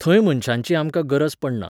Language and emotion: Goan Konkani, neutral